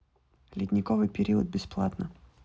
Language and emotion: Russian, neutral